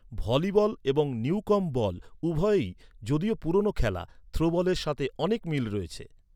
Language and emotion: Bengali, neutral